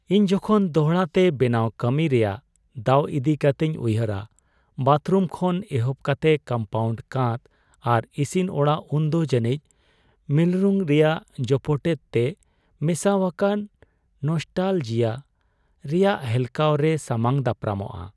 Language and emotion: Santali, sad